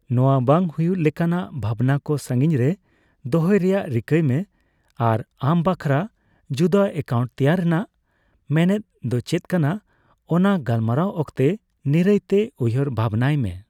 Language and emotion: Santali, neutral